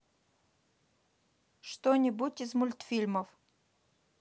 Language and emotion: Russian, neutral